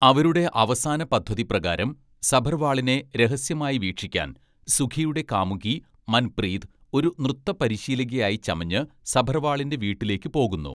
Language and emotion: Malayalam, neutral